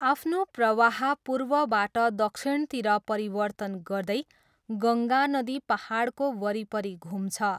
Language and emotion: Nepali, neutral